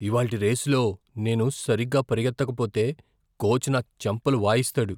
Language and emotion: Telugu, fearful